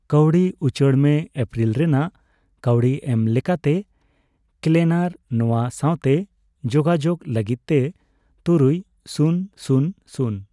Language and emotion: Santali, neutral